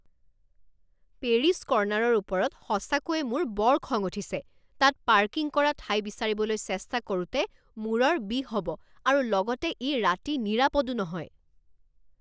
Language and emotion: Assamese, angry